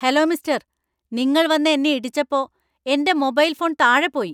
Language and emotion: Malayalam, angry